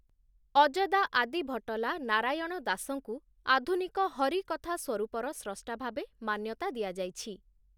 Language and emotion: Odia, neutral